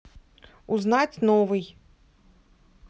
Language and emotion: Russian, neutral